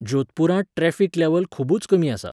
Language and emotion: Goan Konkani, neutral